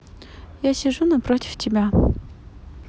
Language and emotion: Russian, neutral